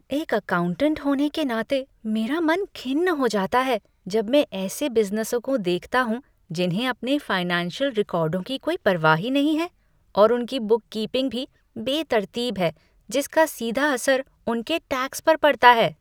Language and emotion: Hindi, disgusted